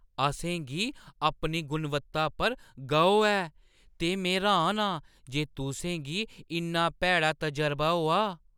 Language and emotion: Dogri, surprised